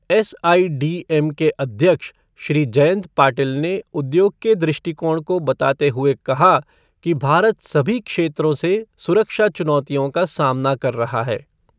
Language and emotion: Hindi, neutral